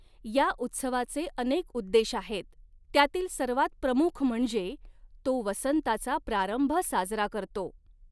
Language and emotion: Marathi, neutral